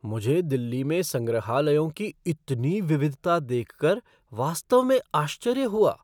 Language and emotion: Hindi, surprised